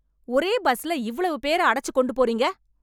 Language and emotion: Tamil, angry